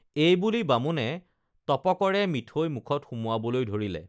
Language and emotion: Assamese, neutral